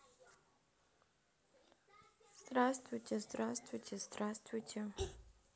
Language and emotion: Russian, sad